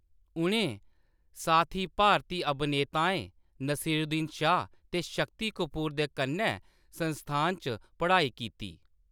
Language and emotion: Dogri, neutral